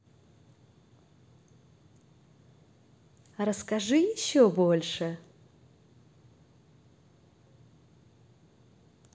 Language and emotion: Russian, positive